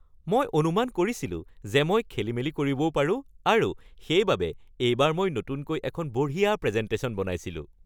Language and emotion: Assamese, happy